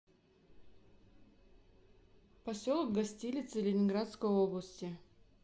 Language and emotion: Russian, neutral